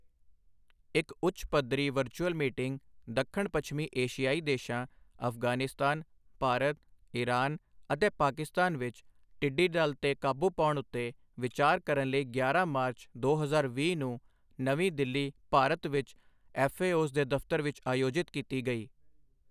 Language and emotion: Punjabi, neutral